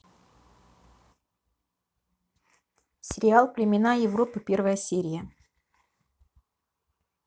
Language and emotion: Russian, neutral